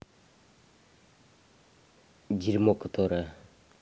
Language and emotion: Russian, angry